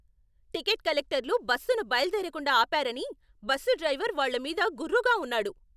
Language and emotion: Telugu, angry